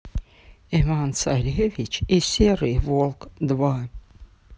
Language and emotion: Russian, neutral